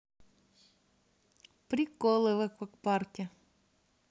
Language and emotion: Russian, positive